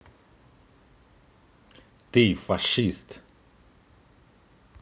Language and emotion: Russian, angry